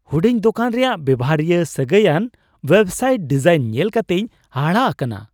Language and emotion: Santali, surprised